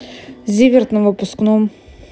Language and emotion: Russian, neutral